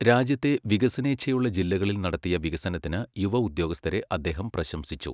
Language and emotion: Malayalam, neutral